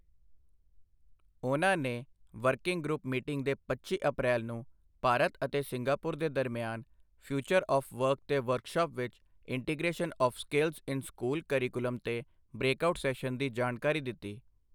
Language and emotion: Punjabi, neutral